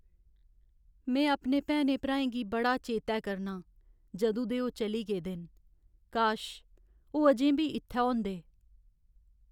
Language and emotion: Dogri, sad